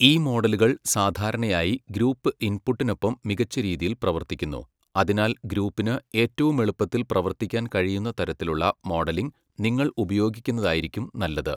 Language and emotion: Malayalam, neutral